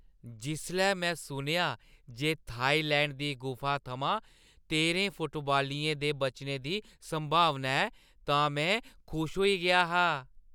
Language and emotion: Dogri, happy